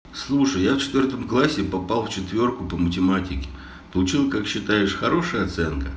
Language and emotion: Russian, neutral